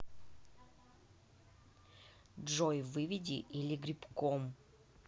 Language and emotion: Russian, angry